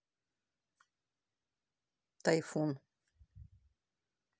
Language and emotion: Russian, neutral